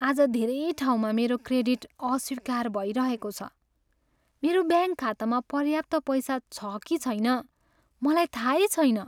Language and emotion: Nepali, sad